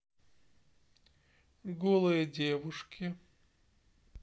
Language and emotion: Russian, neutral